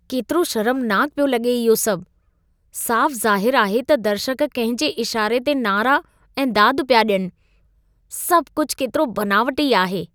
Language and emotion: Sindhi, disgusted